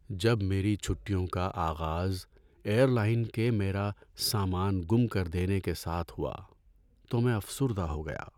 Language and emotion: Urdu, sad